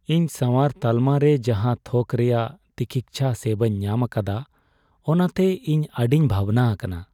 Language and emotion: Santali, sad